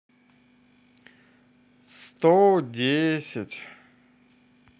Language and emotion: Russian, positive